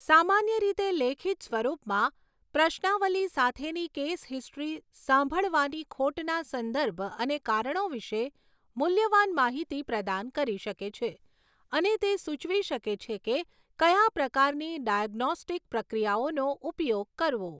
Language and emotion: Gujarati, neutral